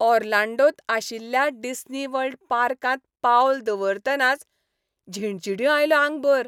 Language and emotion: Goan Konkani, happy